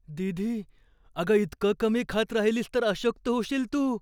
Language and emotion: Marathi, fearful